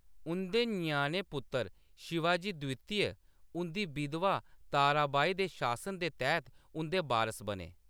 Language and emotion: Dogri, neutral